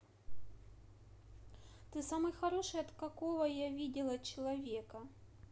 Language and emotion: Russian, positive